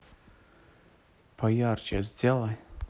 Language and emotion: Russian, neutral